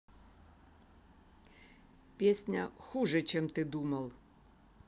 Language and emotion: Russian, neutral